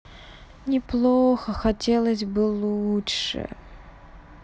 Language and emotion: Russian, sad